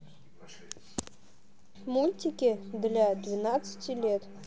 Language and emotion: Russian, neutral